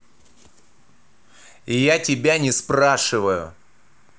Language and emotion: Russian, angry